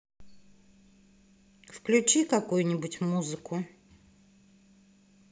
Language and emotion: Russian, neutral